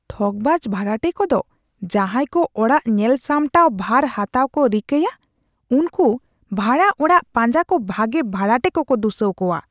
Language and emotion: Santali, disgusted